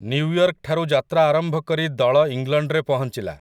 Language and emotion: Odia, neutral